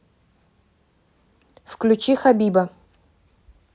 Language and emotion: Russian, neutral